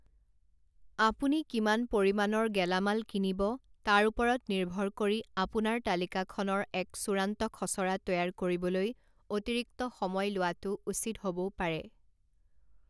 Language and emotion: Assamese, neutral